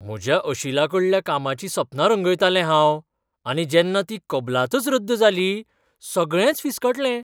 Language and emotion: Goan Konkani, surprised